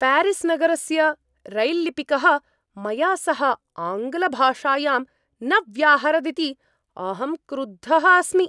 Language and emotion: Sanskrit, angry